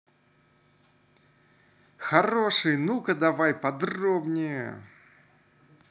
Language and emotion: Russian, positive